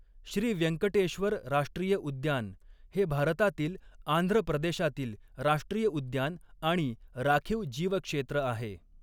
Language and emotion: Marathi, neutral